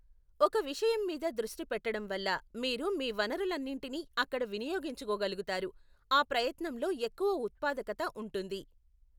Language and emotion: Telugu, neutral